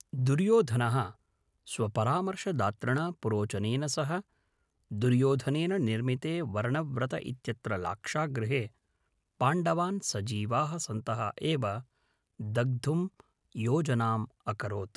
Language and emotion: Sanskrit, neutral